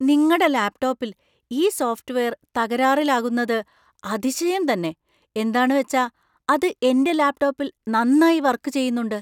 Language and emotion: Malayalam, surprised